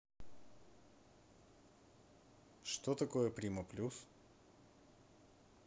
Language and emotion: Russian, neutral